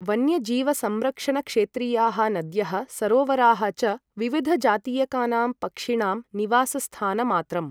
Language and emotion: Sanskrit, neutral